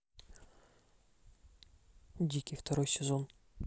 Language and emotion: Russian, neutral